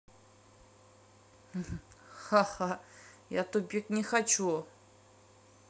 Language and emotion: Russian, neutral